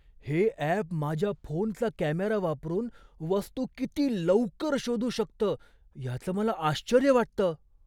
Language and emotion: Marathi, surprised